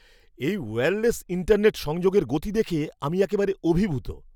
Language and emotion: Bengali, surprised